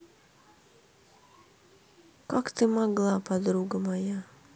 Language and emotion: Russian, sad